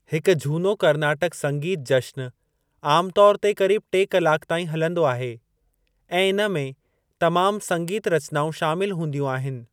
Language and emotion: Sindhi, neutral